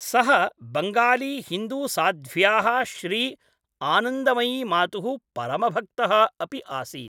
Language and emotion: Sanskrit, neutral